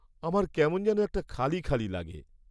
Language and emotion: Bengali, sad